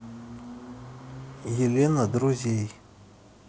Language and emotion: Russian, neutral